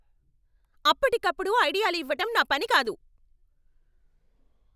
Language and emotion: Telugu, angry